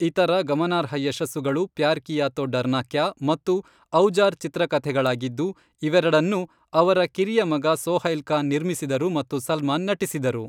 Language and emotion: Kannada, neutral